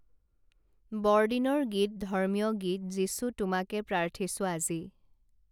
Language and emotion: Assamese, neutral